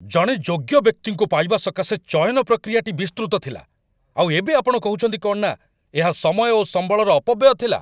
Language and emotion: Odia, angry